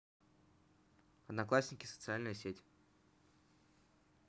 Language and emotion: Russian, neutral